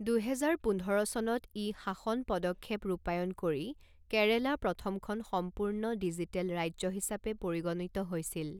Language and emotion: Assamese, neutral